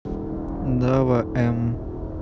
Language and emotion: Russian, neutral